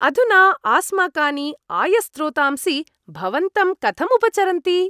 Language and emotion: Sanskrit, happy